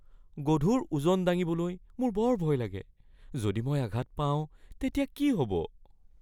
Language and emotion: Assamese, fearful